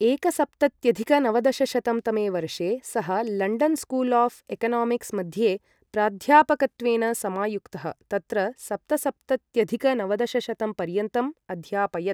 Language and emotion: Sanskrit, neutral